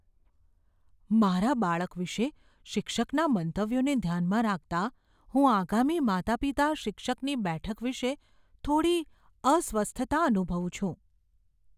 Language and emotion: Gujarati, fearful